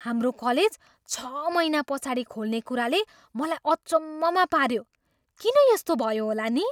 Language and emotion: Nepali, surprised